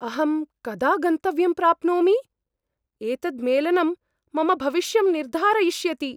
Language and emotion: Sanskrit, fearful